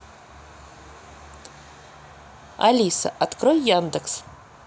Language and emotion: Russian, neutral